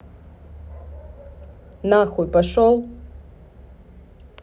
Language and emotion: Russian, angry